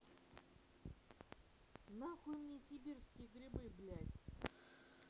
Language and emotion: Russian, angry